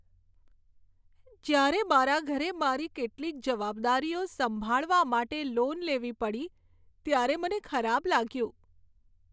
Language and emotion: Gujarati, sad